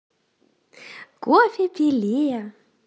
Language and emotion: Russian, positive